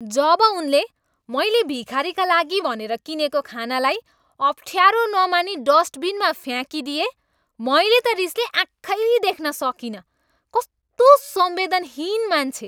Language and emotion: Nepali, angry